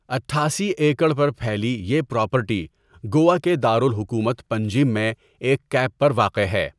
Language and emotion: Urdu, neutral